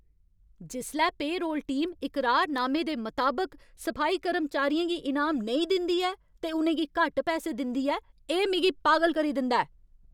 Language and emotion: Dogri, angry